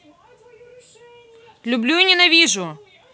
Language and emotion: Russian, neutral